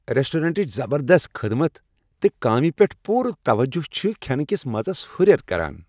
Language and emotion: Kashmiri, happy